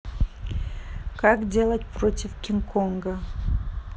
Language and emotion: Russian, neutral